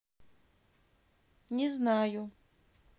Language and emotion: Russian, neutral